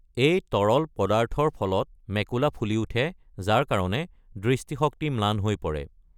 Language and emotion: Assamese, neutral